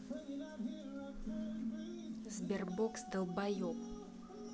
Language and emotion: Russian, neutral